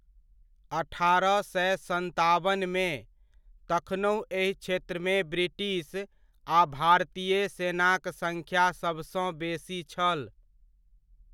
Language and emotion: Maithili, neutral